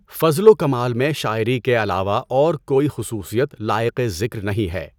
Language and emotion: Urdu, neutral